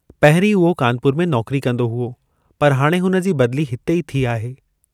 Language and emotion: Sindhi, neutral